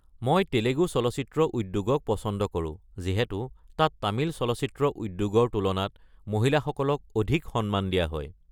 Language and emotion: Assamese, neutral